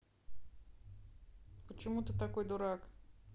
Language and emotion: Russian, neutral